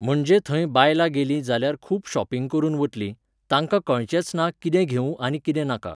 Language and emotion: Goan Konkani, neutral